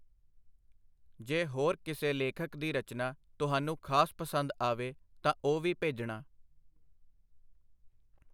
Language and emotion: Punjabi, neutral